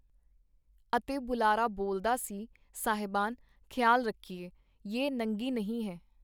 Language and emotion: Punjabi, neutral